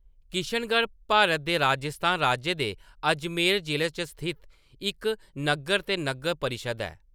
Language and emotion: Dogri, neutral